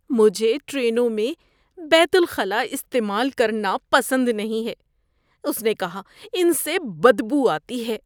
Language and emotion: Urdu, disgusted